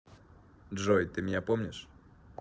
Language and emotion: Russian, neutral